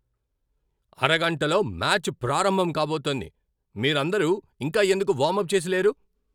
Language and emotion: Telugu, angry